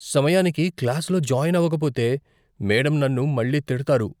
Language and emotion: Telugu, fearful